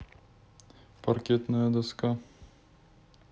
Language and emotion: Russian, neutral